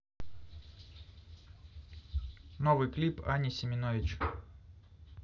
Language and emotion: Russian, neutral